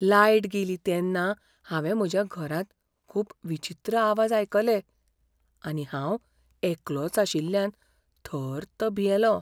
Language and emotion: Goan Konkani, fearful